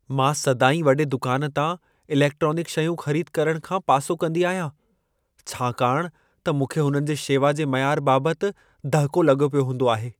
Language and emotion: Sindhi, fearful